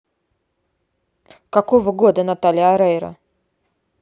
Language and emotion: Russian, neutral